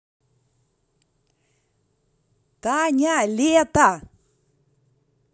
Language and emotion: Russian, positive